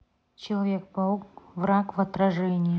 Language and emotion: Russian, neutral